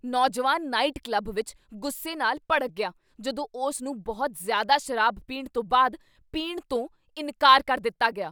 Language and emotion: Punjabi, angry